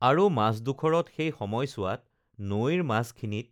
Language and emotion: Assamese, neutral